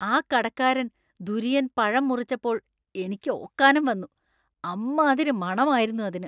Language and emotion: Malayalam, disgusted